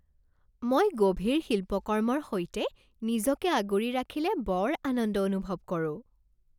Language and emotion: Assamese, happy